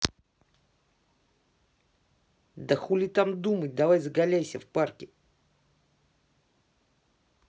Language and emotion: Russian, angry